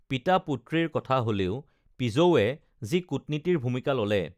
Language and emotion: Assamese, neutral